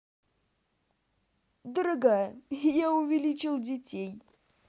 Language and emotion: Russian, positive